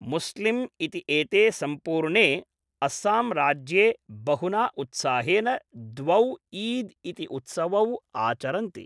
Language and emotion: Sanskrit, neutral